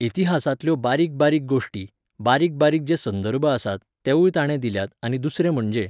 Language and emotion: Goan Konkani, neutral